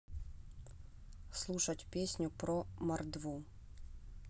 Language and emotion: Russian, neutral